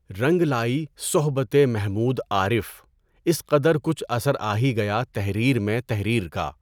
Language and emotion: Urdu, neutral